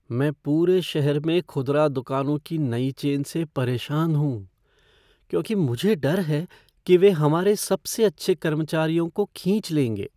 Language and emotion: Hindi, fearful